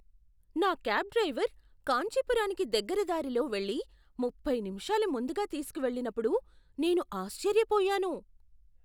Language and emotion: Telugu, surprised